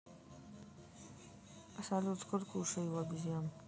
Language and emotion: Russian, sad